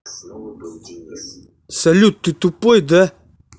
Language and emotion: Russian, angry